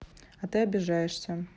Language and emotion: Russian, neutral